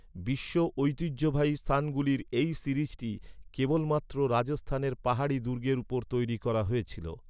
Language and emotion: Bengali, neutral